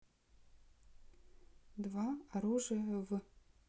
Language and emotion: Russian, neutral